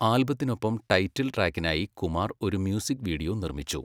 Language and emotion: Malayalam, neutral